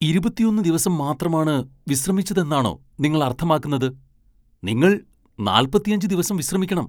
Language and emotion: Malayalam, surprised